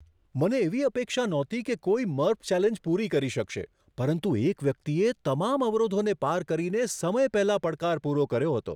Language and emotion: Gujarati, surprised